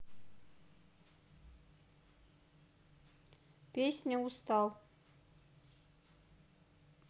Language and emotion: Russian, neutral